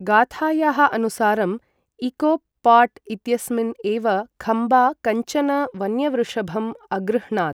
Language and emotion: Sanskrit, neutral